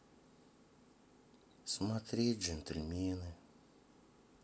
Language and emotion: Russian, sad